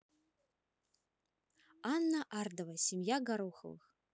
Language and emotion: Russian, neutral